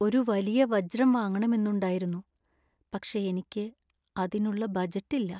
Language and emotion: Malayalam, sad